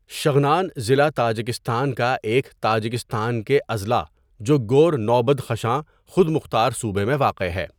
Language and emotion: Urdu, neutral